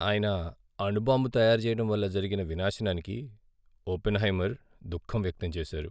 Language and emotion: Telugu, sad